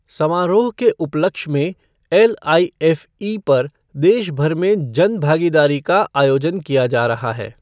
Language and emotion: Hindi, neutral